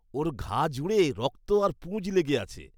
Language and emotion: Bengali, disgusted